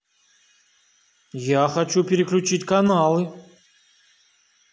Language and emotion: Russian, angry